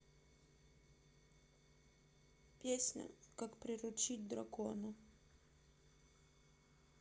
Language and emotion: Russian, sad